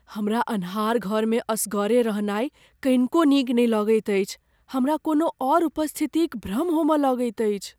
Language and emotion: Maithili, fearful